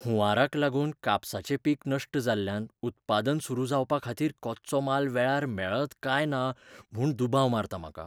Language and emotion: Goan Konkani, fearful